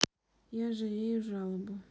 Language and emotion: Russian, sad